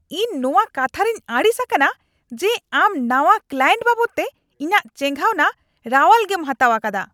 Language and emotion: Santali, angry